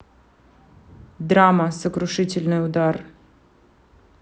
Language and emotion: Russian, neutral